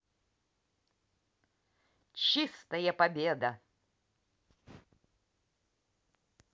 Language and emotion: Russian, positive